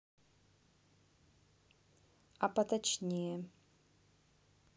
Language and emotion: Russian, neutral